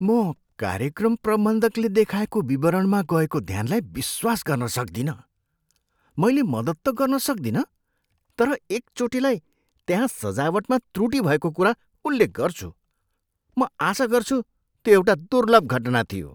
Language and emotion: Nepali, surprised